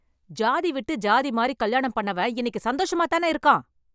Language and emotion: Tamil, angry